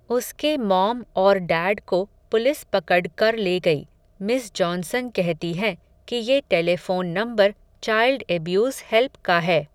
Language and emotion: Hindi, neutral